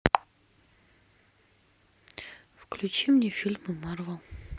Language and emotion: Russian, sad